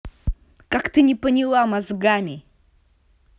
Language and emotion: Russian, angry